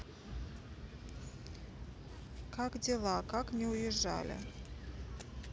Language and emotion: Russian, neutral